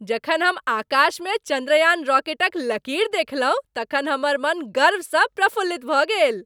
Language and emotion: Maithili, happy